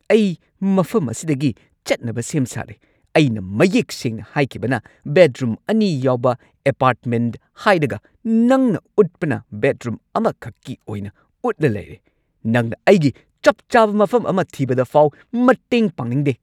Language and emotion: Manipuri, angry